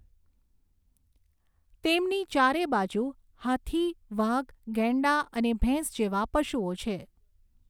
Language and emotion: Gujarati, neutral